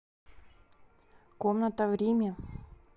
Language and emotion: Russian, neutral